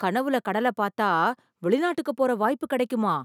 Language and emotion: Tamil, surprised